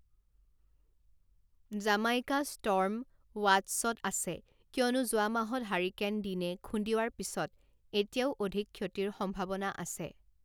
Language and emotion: Assamese, neutral